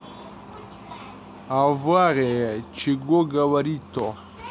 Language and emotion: Russian, neutral